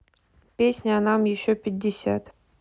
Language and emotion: Russian, neutral